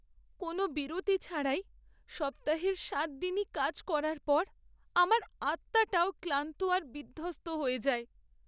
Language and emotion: Bengali, sad